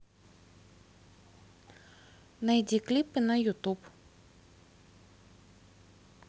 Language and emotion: Russian, neutral